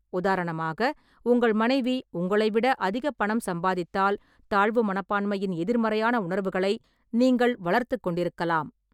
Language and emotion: Tamil, neutral